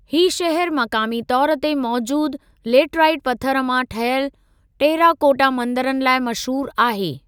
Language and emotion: Sindhi, neutral